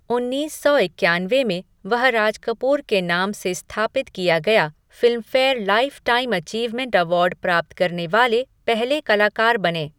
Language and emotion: Hindi, neutral